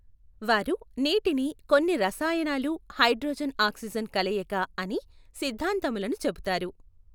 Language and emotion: Telugu, neutral